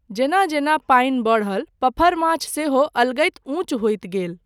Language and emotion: Maithili, neutral